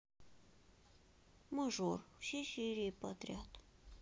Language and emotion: Russian, sad